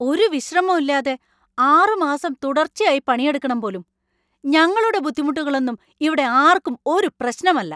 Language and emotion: Malayalam, angry